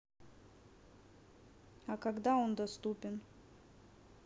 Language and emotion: Russian, neutral